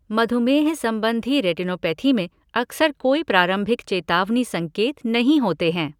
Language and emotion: Hindi, neutral